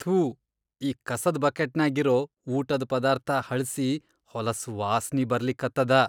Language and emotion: Kannada, disgusted